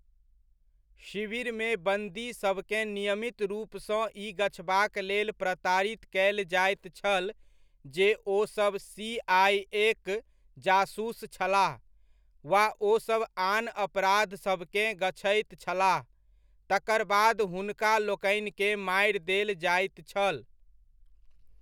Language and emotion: Maithili, neutral